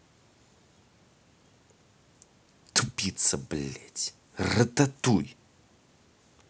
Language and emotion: Russian, angry